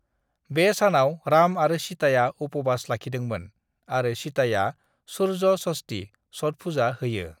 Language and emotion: Bodo, neutral